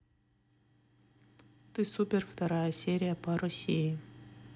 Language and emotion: Russian, neutral